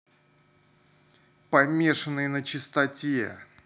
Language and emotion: Russian, neutral